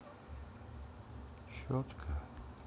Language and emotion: Russian, neutral